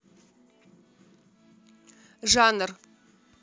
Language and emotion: Russian, neutral